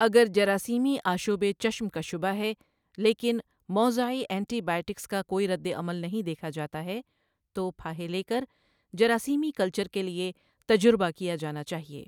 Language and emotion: Urdu, neutral